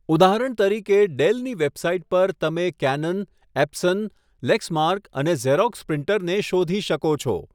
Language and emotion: Gujarati, neutral